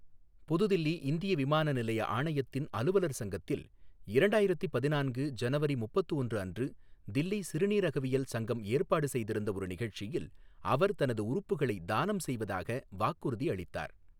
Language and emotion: Tamil, neutral